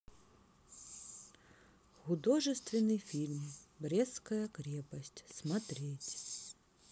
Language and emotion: Russian, neutral